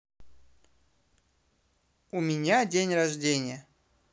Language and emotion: Russian, positive